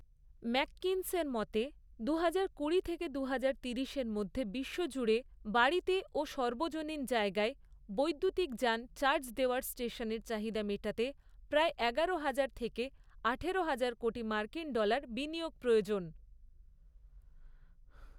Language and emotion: Bengali, neutral